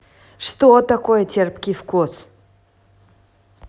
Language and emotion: Russian, neutral